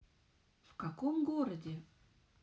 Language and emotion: Russian, neutral